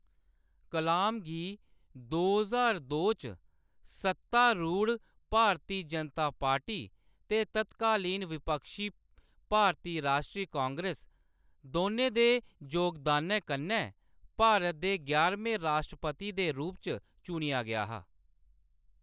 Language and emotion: Dogri, neutral